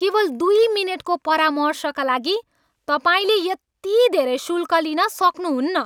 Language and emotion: Nepali, angry